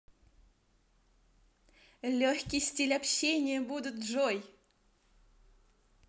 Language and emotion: Russian, positive